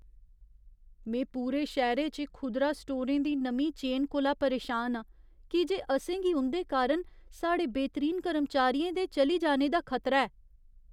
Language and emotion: Dogri, fearful